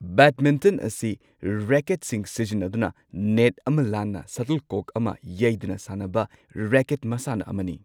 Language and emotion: Manipuri, neutral